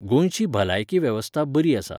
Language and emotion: Goan Konkani, neutral